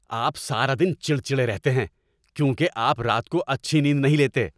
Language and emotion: Urdu, angry